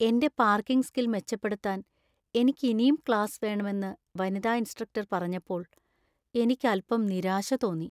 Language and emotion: Malayalam, sad